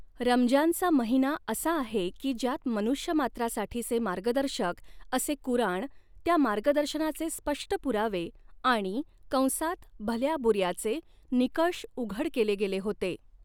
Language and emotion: Marathi, neutral